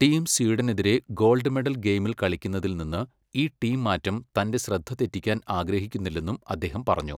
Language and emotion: Malayalam, neutral